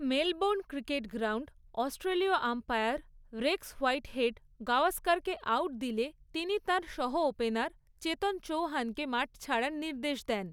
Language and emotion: Bengali, neutral